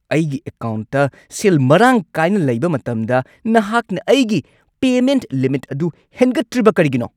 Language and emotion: Manipuri, angry